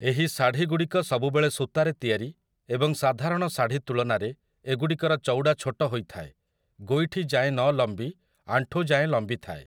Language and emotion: Odia, neutral